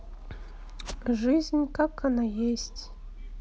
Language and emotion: Russian, sad